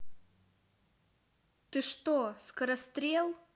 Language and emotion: Russian, neutral